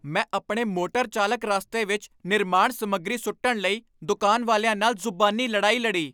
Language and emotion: Punjabi, angry